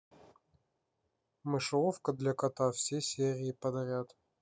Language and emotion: Russian, neutral